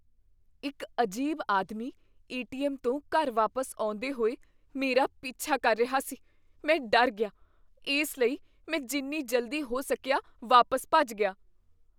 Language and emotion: Punjabi, fearful